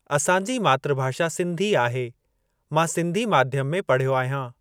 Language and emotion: Sindhi, neutral